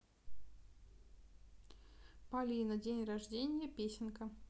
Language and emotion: Russian, neutral